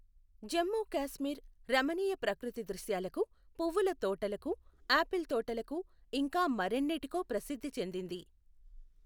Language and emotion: Telugu, neutral